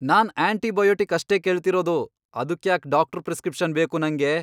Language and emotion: Kannada, angry